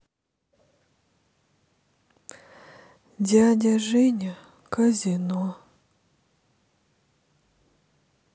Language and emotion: Russian, sad